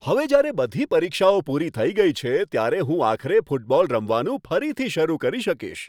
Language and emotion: Gujarati, happy